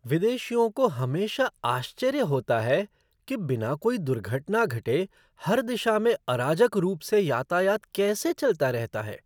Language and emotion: Hindi, surprised